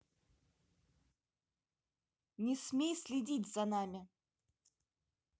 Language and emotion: Russian, angry